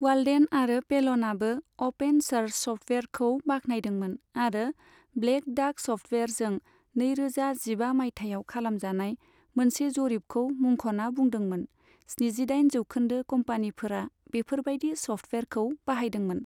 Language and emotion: Bodo, neutral